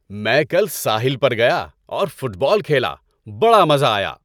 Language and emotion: Urdu, happy